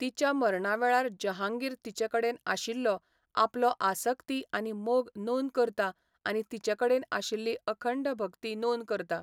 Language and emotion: Goan Konkani, neutral